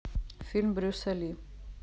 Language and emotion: Russian, neutral